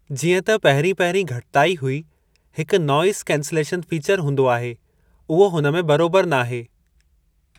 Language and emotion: Sindhi, neutral